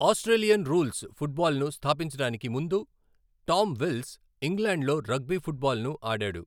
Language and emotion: Telugu, neutral